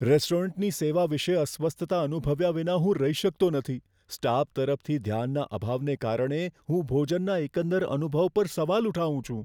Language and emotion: Gujarati, fearful